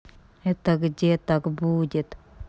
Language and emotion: Russian, sad